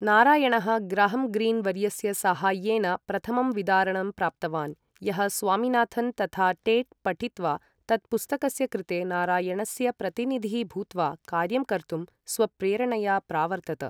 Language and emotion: Sanskrit, neutral